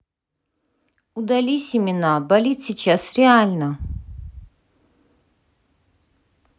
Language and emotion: Russian, angry